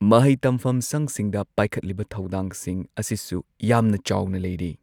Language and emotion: Manipuri, neutral